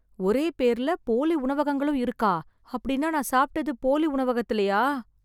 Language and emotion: Tamil, fearful